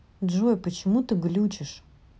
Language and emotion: Russian, neutral